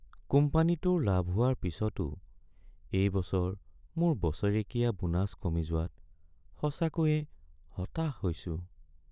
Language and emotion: Assamese, sad